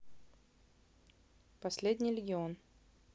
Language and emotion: Russian, neutral